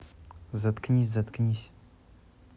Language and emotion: Russian, angry